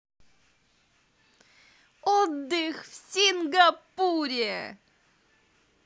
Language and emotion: Russian, positive